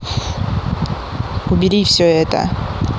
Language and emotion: Russian, angry